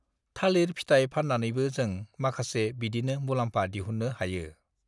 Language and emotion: Bodo, neutral